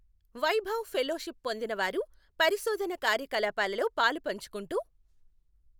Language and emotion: Telugu, neutral